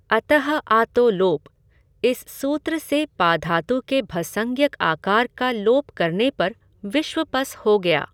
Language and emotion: Hindi, neutral